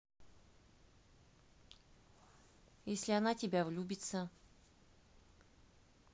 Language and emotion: Russian, neutral